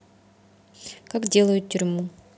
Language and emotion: Russian, neutral